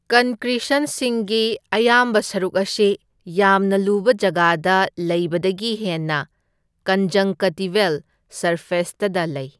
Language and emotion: Manipuri, neutral